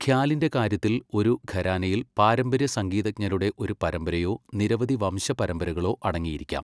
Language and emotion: Malayalam, neutral